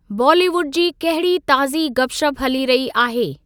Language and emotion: Sindhi, neutral